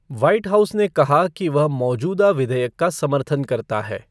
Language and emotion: Hindi, neutral